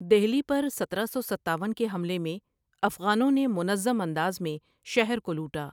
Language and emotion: Urdu, neutral